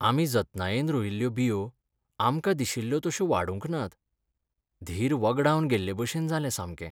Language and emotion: Goan Konkani, sad